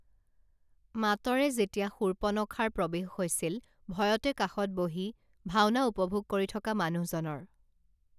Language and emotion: Assamese, neutral